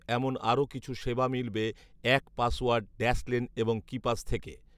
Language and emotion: Bengali, neutral